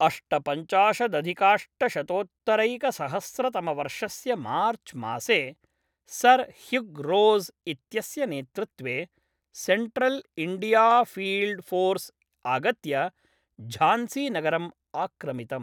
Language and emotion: Sanskrit, neutral